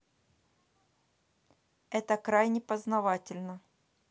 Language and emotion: Russian, neutral